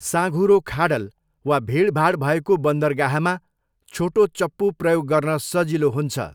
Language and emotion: Nepali, neutral